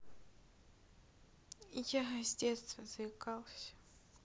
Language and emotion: Russian, sad